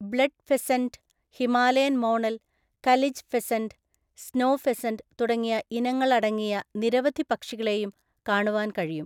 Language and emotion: Malayalam, neutral